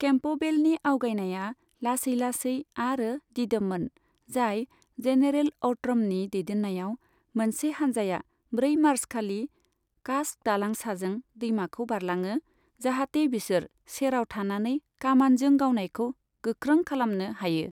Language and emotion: Bodo, neutral